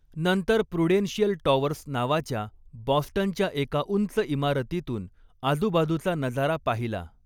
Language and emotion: Marathi, neutral